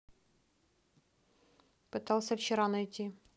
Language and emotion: Russian, neutral